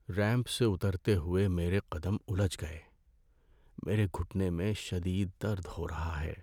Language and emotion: Urdu, sad